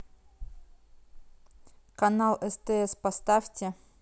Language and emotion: Russian, neutral